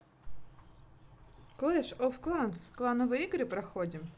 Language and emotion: Russian, positive